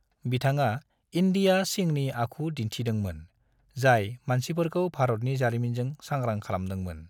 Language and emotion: Bodo, neutral